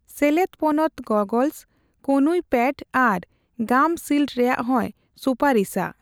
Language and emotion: Santali, neutral